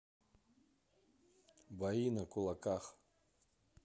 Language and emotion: Russian, neutral